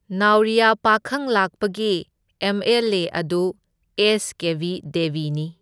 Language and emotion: Manipuri, neutral